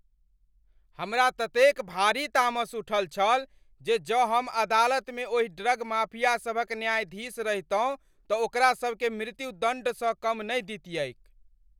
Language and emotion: Maithili, angry